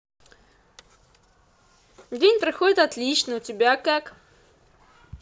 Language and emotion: Russian, positive